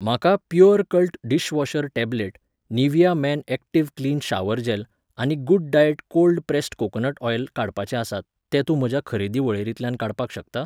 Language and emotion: Goan Konkani, neutral